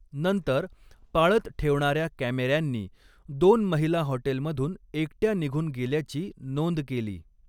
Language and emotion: Marathi, neutral